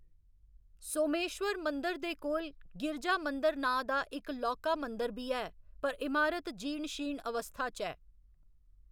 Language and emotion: Dogri, neutral